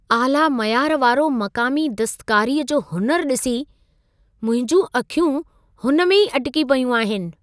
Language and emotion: Sindhi, surprised